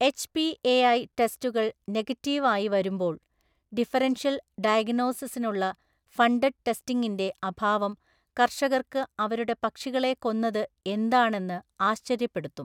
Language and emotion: Malayalam, neutral